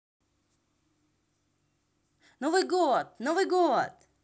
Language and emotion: Russian, positive